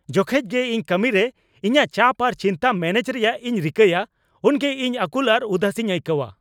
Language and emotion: Santali, angry